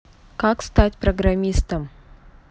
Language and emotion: Russian, neutral